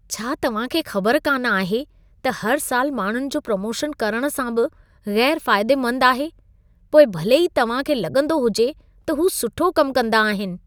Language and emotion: Sindhi, disgusted